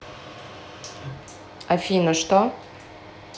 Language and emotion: Russian, neutral